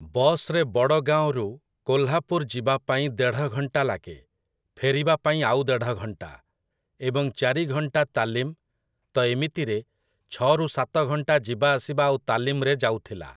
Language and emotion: Odia, neutral